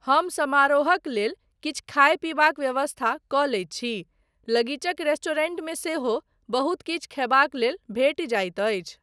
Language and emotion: Maithili, neutral